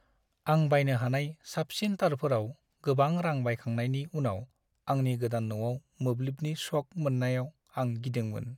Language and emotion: Bodo, sad